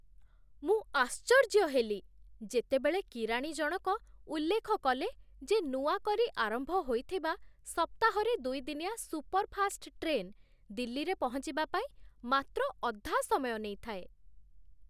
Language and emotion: Odia, surprised